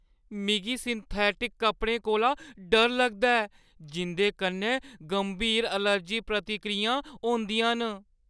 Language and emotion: Dogri, fearful